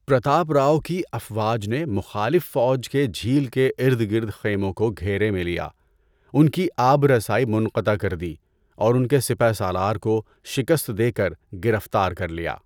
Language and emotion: Urdu, neutral